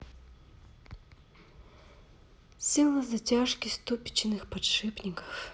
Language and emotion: Russian, sad